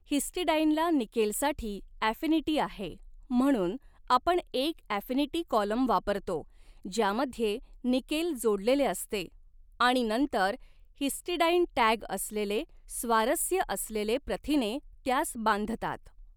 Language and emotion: Marathi, neutral